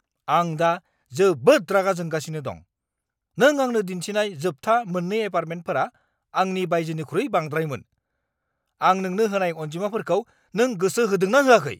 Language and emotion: Bodo, angry